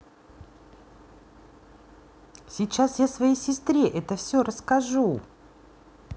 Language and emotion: Russian, neutral